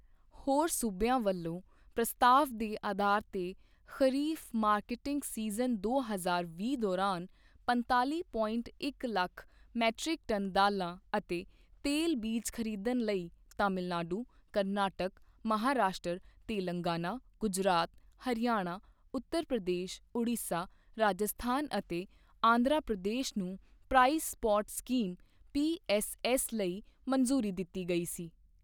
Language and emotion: Punjabi, neutral